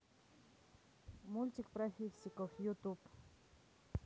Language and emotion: Russian, neutral